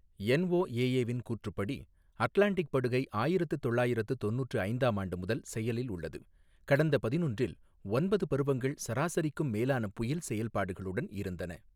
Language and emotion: Tamil, neutral